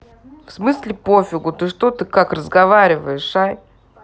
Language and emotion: Russian, angry